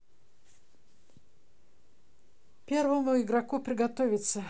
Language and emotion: Russian, neutral